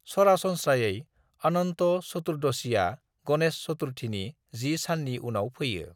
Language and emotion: Bodo, neutral